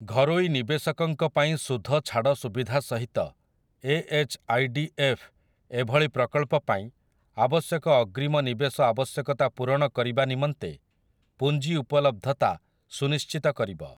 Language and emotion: Odia, neutral